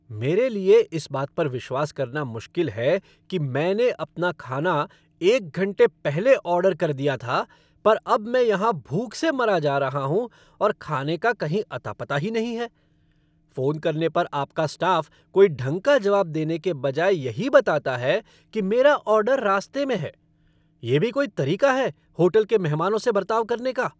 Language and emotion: Hindi, angry